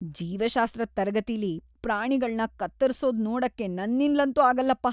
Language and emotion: Kannada, disgusted